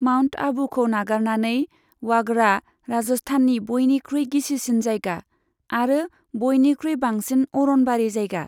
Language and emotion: Bodo, neutral